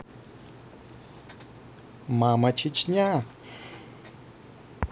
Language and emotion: Russian, positive